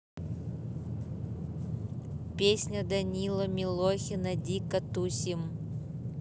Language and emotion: Russian, neutral